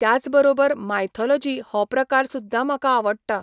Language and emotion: Goan Konkani, neutral